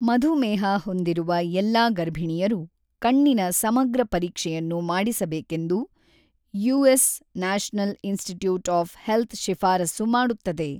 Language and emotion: Kannada, neutral